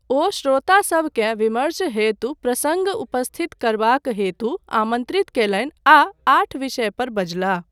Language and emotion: Maithili, neutral